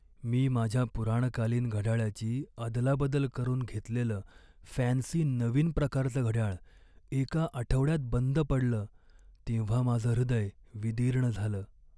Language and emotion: Marathi, sad